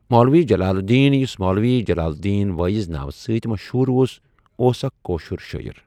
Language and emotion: Kashmiri, neutral